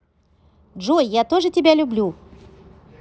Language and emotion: Russian, positive